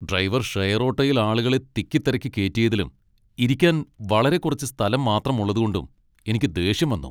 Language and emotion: Malayalam, angry